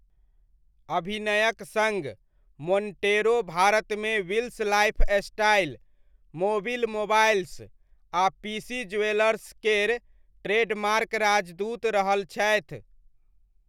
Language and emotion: Maithili, neutral